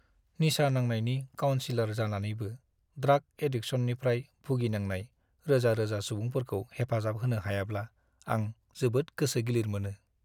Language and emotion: Bodo, sad